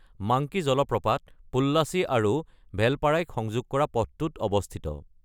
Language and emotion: Assamese, neutral